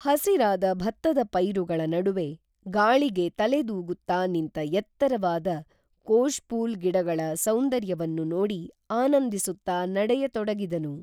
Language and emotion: Kannada, neutral